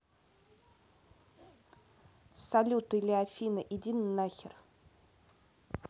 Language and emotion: Russian, neutral